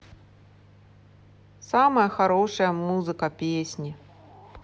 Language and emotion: Russian, neutral